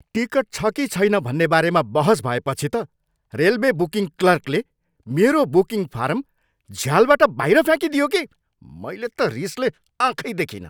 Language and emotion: Nepali, angry